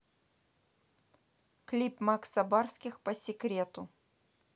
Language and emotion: Russian, neutral